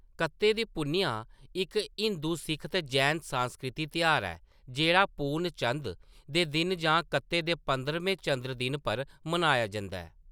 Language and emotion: Dogri, neutral